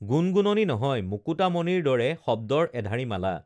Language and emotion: Assamese, neutral